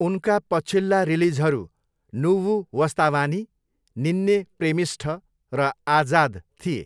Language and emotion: Nepali, neutral